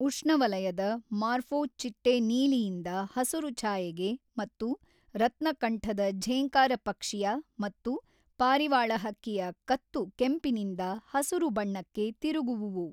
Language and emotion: Kannada, neutral